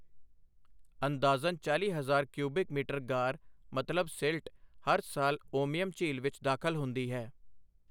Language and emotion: Punjabi, neutral